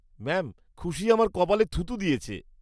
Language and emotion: Bengali, disgusted